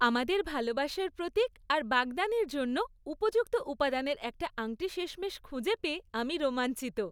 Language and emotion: Bengali, happy